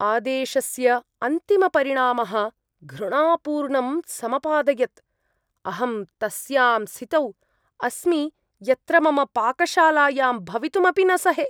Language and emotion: Sanskrit, disgusted